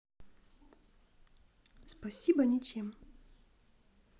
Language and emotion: Russian, neutral